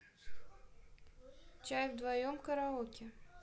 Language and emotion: Russian, neutral